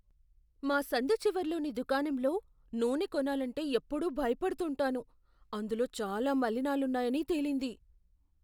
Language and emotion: Telugu, fearful